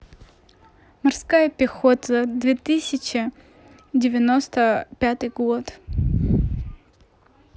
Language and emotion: Russian, neutral